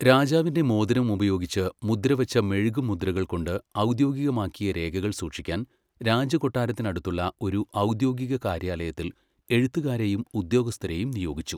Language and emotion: Malayalam, neutral